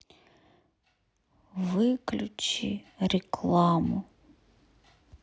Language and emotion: Russian, sad